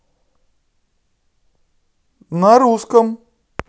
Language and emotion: Russian, positive